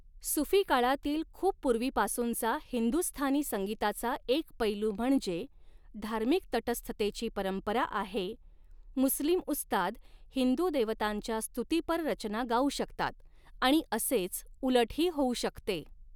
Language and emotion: Marathi, neutral